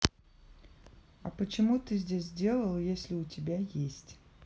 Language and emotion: Russian, neutral